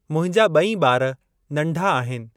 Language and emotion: Sindhi, neutral